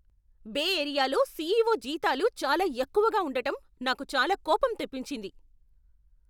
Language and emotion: Telugu, angry